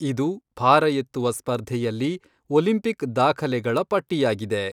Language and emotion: Kannada, neutral